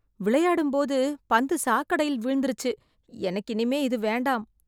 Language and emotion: Tamil, disgusted